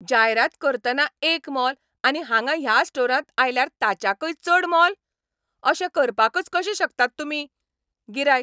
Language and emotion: Goan Konkani, angry